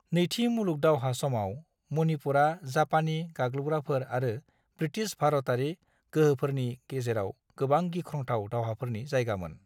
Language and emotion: Bodo, neutral